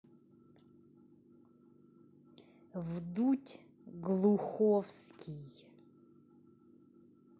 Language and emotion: Russian, angry